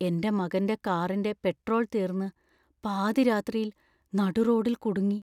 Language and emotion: Malayalam, fearful